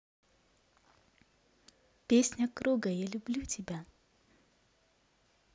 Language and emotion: Russian, positive